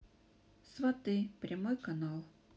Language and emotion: Russian, sad